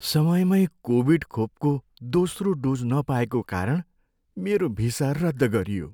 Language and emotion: Nepali, sad